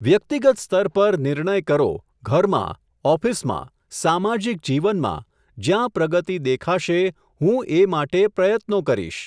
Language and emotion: Gujarati, neutral